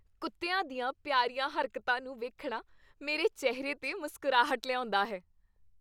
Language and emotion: Punjabi, happy